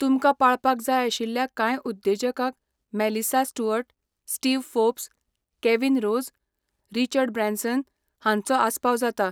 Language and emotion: Goan Konkani, neutral